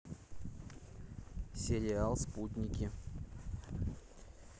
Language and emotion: Russian, neutral